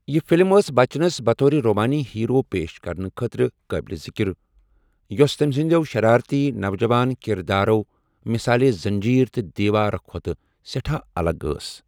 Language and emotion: Kashmiri, neutral